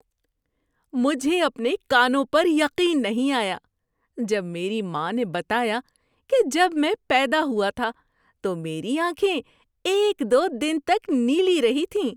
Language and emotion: Urdu, surprised